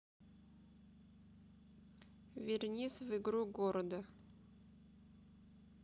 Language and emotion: Russian, neutral